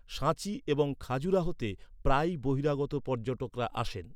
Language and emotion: Bengali, neutral